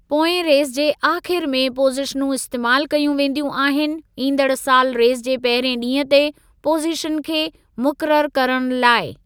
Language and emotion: Sindhi, neutral